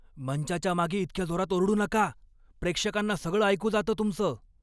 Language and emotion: Marathi, angry